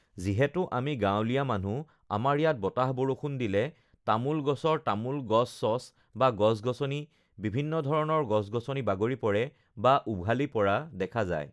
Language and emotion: Assamese, neutral